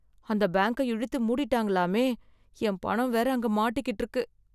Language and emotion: Tamil, sad